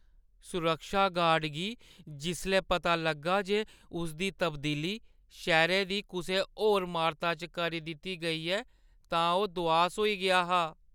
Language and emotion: Dogri, sad